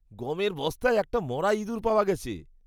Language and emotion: Bengali, disgusted